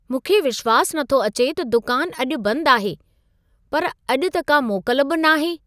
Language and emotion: Sindhi, surprised